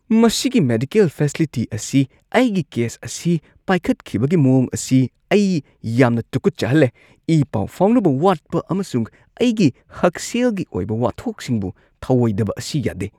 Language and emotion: Manipuri, disgusted